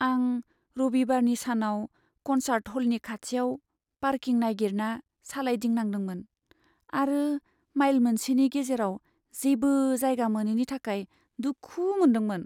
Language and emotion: Bodo, sad